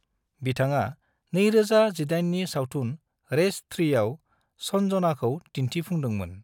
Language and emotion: Bodo, neutral